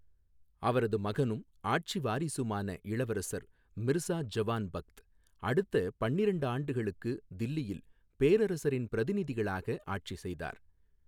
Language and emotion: Tamil, neutral